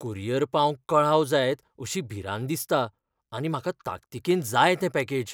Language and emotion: Goan Konkani, fearful